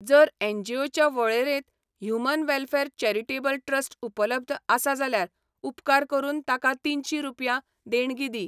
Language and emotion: Goan Konkani, neutral